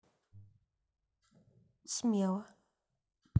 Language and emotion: Russian, neutral